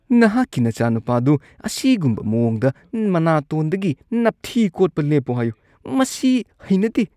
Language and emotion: Manipuri, disgusted